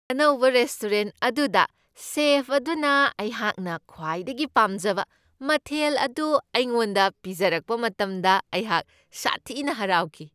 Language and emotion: Manipuri, happy